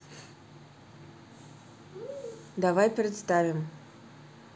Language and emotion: Russian, neutral